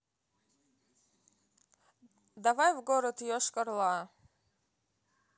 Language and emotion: Russian, neutral